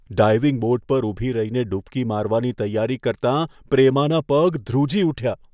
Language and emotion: Gujarati, fearful